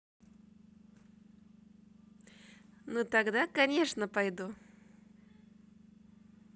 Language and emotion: Russian, positive